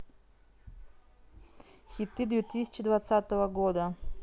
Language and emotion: Russian, neutral